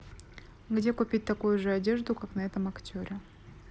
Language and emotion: Russian, neutral